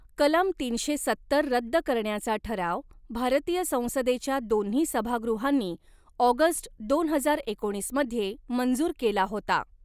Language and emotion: Marathi, neutral